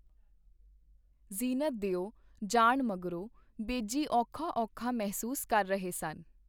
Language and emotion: Punjabi, neutral